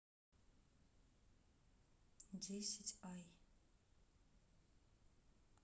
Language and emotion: Russian, neutral